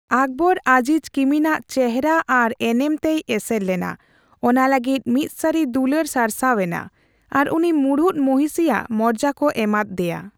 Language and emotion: Santali, neutral